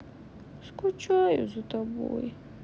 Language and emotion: Russian, sad